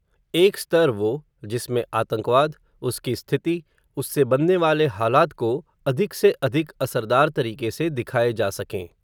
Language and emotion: Hindi, neutral